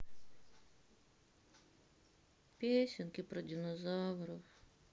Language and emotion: Russian, sad